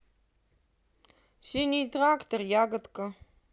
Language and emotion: Russian, neutral